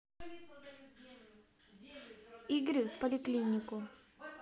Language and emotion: Russian, neutral